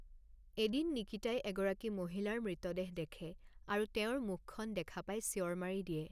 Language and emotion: Assamese, neutral